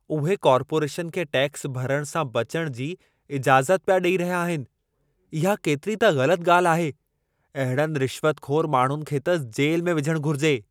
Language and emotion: Sindhi, angry